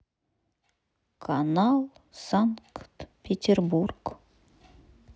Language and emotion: Russian, sad